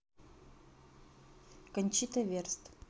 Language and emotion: Russian, neutral